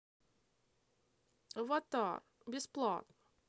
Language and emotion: Russian, sad